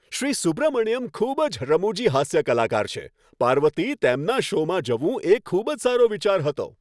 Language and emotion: Gujarati, happy